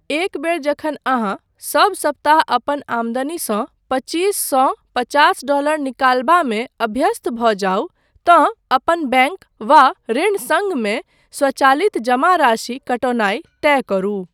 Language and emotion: Maithili, neutral